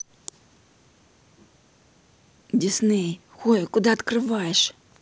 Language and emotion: Russian, angry